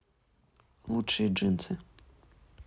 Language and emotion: Russian, neutral